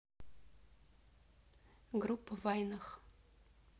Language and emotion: Russian, neutral